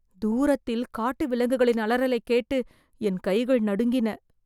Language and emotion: Tamil, fearful